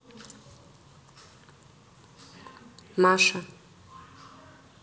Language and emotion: Russian, neutral